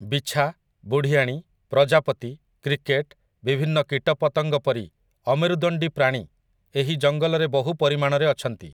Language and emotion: Odia, neutral